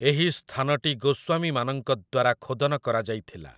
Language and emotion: Odia, neutral